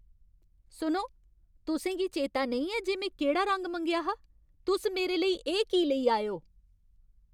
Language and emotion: Dogri, angry